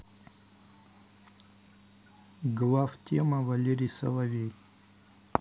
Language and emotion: Russian, neutral